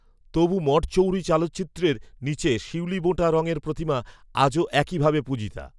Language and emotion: Bengali, neutral